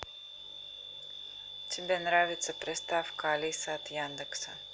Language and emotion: Russian, neutral